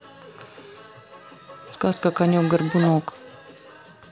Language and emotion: Russian, neutral